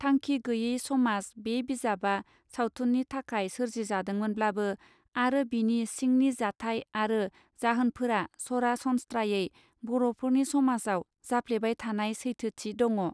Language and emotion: Bodo, neutral